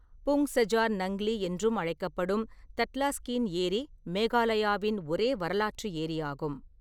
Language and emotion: Tamil, neutral